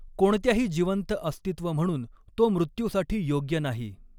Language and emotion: Marathi, neutral